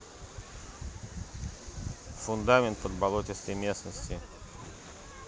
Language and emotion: Russian, neutral